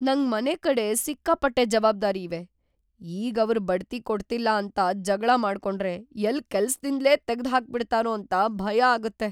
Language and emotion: Kannada, fearful